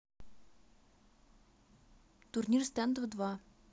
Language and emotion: Russian, neutral